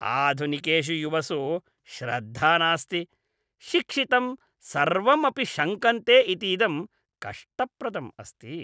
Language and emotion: Sanskrit, disgusted